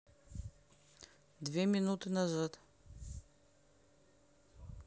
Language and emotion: Russian, neutral